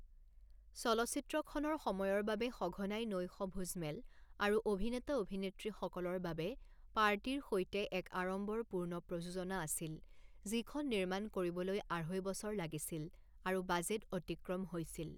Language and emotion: Assamese, neutral